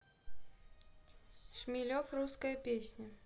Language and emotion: Russian, neutral